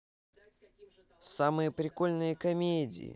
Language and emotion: Russian, positive